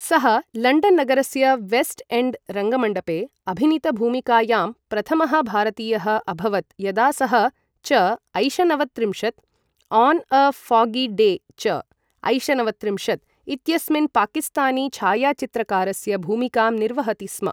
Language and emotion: Sanskrit, neutral